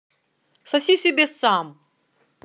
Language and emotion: Russian, angry